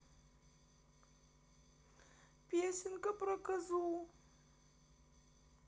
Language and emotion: Russian, sad